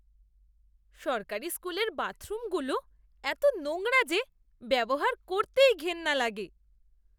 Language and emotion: Bengali, disgusted